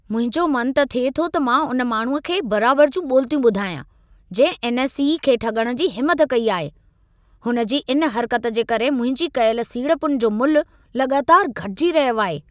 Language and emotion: Sindhi, angry